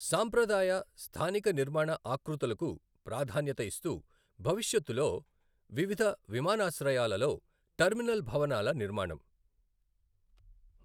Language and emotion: Telugu, neutral